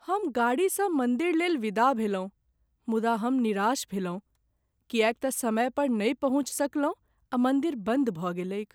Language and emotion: Maithili, sad